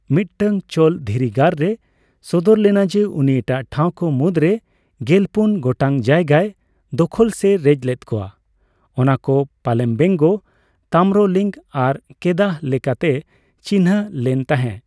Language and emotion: Santali, neutral